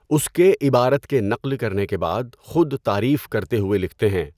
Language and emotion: Urdu, neutral